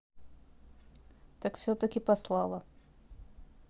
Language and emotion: Russian, neutral